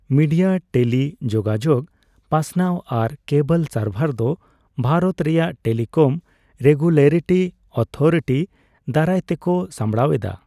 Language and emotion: Santali, neutral